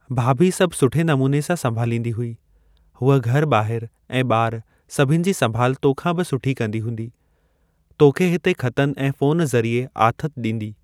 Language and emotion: Sindhi, neutral